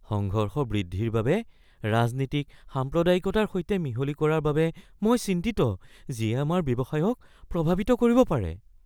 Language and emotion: Assamese, fearful